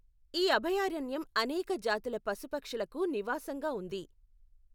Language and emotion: Telugu, neutral